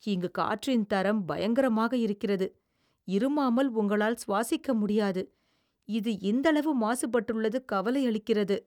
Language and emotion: Tamil, disgusted